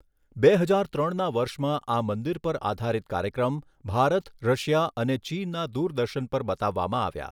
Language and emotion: Gujarati, neutral